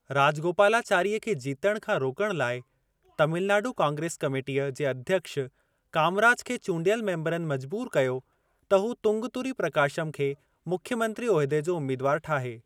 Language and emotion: Sindhi, neutral